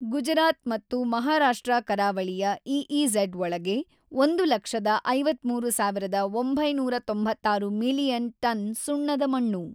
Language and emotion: Kannada, neutral